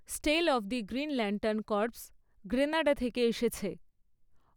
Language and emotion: Bengali, neutral